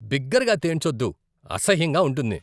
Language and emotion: Telugu, disgusted